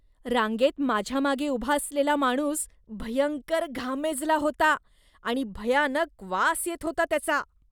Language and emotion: Marathi, disgusted